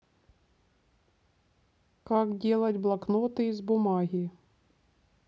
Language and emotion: Russian, neutral